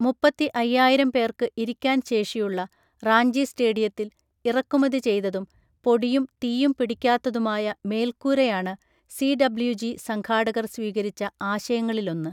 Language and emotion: Malayalam, neutral